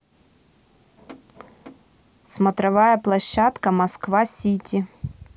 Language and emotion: Russian, neutral